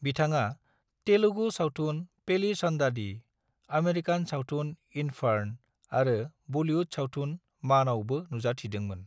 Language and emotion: Bodo, neutral